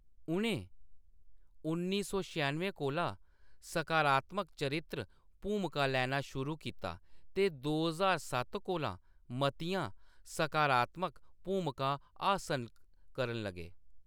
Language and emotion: Dogri, neutral